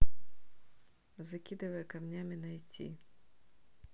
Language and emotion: Russian, neutral